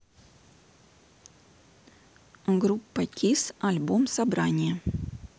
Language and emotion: Russian, neutral